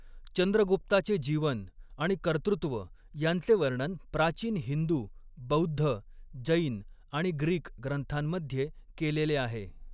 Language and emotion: Marathi, neutral